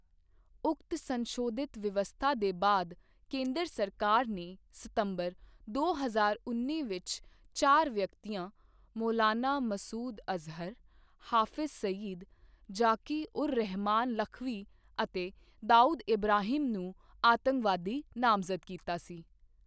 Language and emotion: Punjabi, neutral